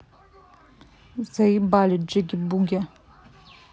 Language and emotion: Russian, angry